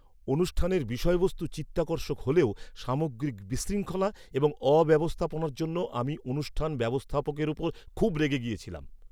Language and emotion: Bengali, angry